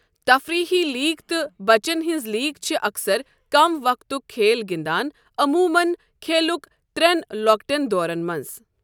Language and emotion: Kashmiri, neutral